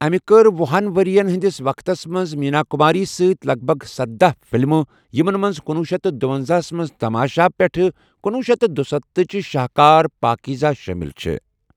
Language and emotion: Kashmiri, neutral